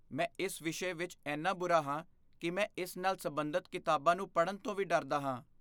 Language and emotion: Punjabi, fearful